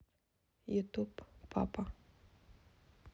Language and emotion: Russian, neutral